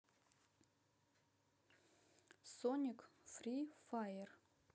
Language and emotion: Russian, neutral